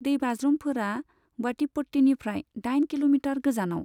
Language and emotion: Bodo, neutral